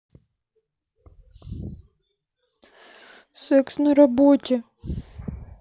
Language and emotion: Russian, sad